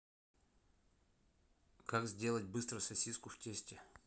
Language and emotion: Russian, neutral